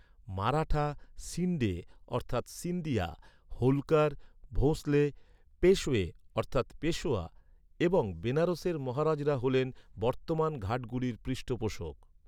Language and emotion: Bengali, neutral